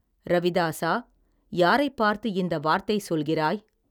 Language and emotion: Tamil, neutral